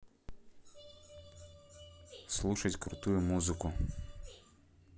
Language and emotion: Russian, neutral